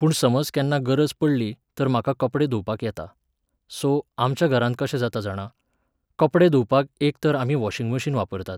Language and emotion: Goan Konkani, neutral